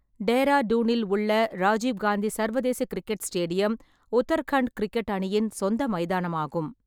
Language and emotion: Tamil, neutral